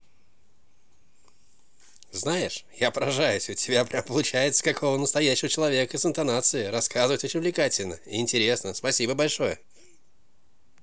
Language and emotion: Russian, positive